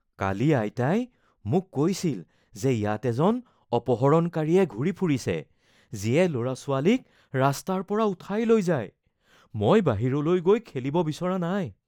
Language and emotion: Assamese, fearful